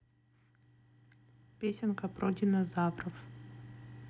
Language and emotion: Russian, neutral